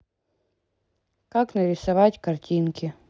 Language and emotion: Russian, neutral